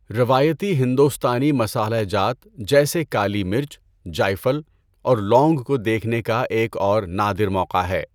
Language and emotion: Urdu, neutral